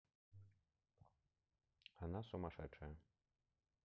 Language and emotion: Russian, neutral